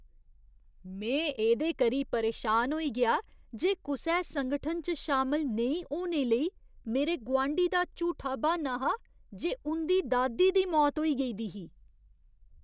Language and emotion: Dogri, disgusted